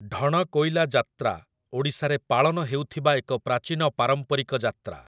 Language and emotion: Odia, neutral